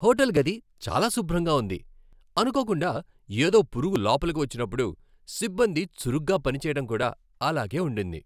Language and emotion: Telugu, happy